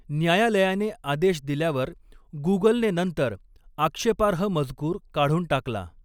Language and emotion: Marathi, neutral